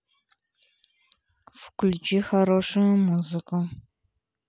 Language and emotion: Russian, neutral